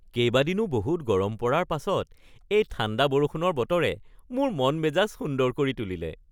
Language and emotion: Assamese, happy